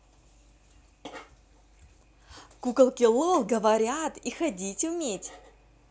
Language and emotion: Russian, positive